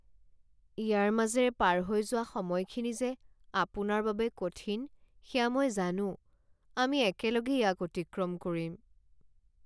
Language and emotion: Assamese, sad